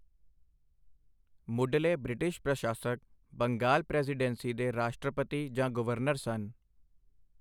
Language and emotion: Punjabi, neutral